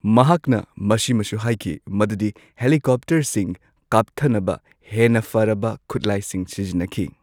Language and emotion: Manipuri, neutral